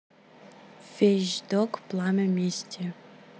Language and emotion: Russian, neutral